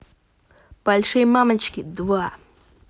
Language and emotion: Russian, positive